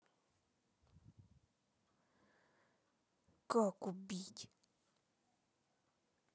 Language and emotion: Russian, angry